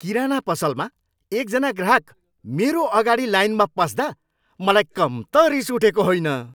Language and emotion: Nepali, angry